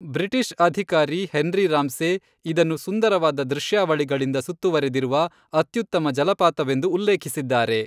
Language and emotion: Kannada, neutral